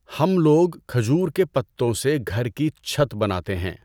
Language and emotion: Urdu, neutral